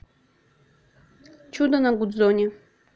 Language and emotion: Russian, neutral